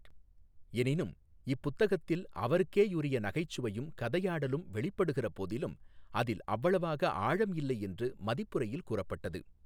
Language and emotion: Tamil, neutral